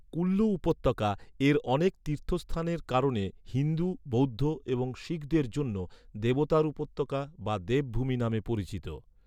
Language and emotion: Bengali, neutral